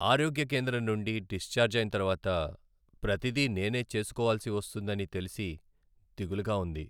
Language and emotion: Telugu, sad